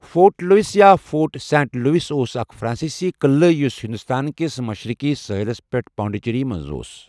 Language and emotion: Kashmiri, neutral